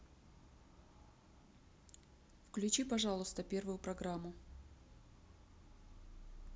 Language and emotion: Russian, neutral